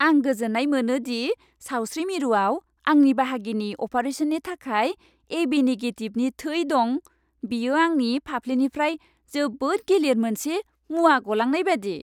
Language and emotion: Bodo, happy